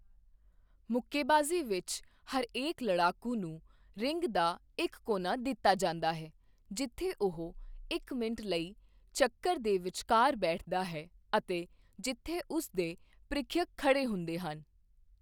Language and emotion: Punjabi, neutral